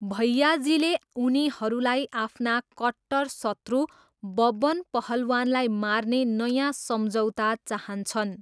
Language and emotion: Nepali, neutral